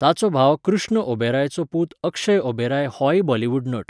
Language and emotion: Goan Konkani, neutral